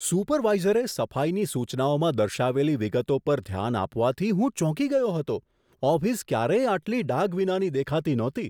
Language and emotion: Gujarati, surprised